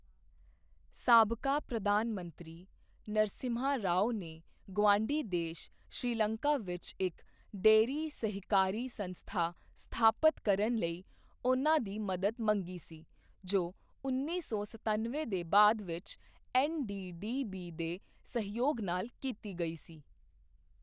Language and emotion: Punjabi, neutral